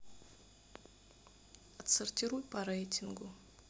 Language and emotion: Russian, sad